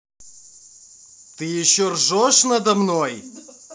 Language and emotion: Russian, angry